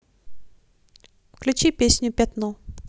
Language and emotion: Russian, neutral